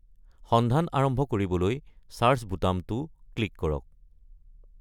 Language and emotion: Assamese, neutral